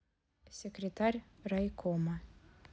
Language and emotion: Russian, neutral